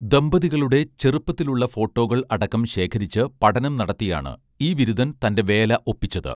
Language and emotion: Malayalam, neutral